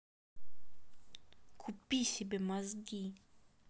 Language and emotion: Russian, angry